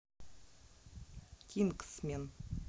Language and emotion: Russian, neutral